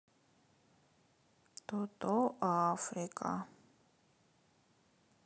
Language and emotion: Russian, sad